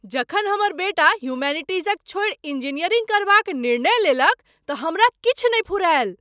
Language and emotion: Maithili, surprised